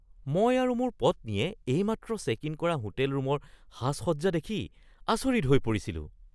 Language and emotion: Assamese, surprised